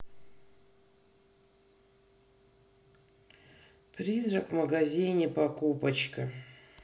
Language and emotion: Russian, sad